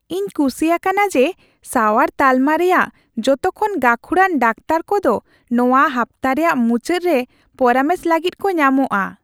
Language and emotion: Santali, happy